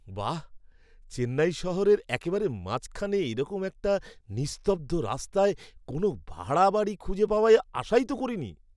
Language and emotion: Bengali, surprised